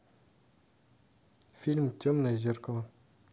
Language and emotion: Russian, neutral